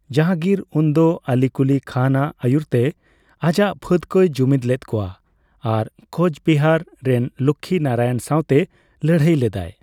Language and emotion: Santali, neutral